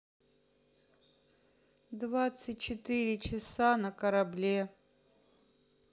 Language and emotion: Russian, neutral